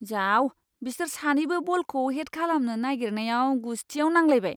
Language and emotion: Bodo, disgusted